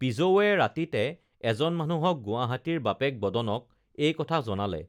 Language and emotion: Assamese, neutral